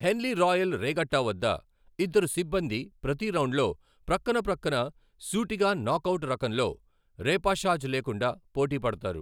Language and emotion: Telugu, neutral